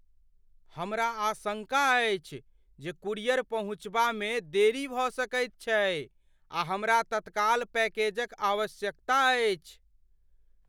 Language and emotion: Maithili, fearful